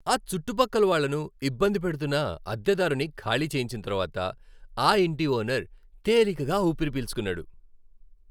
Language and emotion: Telugu, happy